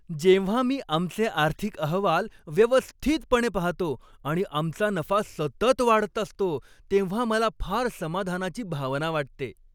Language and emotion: Marathi, happy